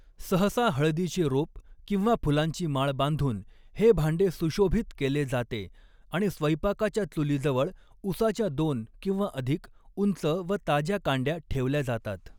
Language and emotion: Marathi, neutral